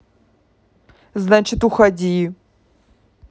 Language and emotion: Russian, angry